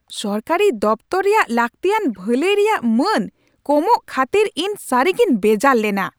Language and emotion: Santali, angry